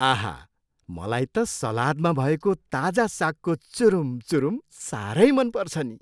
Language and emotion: Nepali, happy